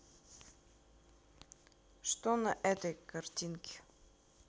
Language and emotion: Russian, neutral